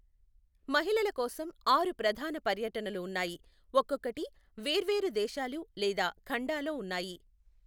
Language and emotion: Telugu, neutral